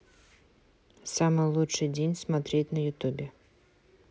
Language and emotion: Russian, neutral